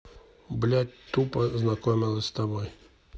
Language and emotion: Russian, neutral